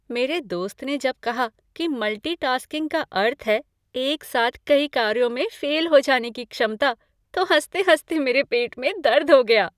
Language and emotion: Hindi, happy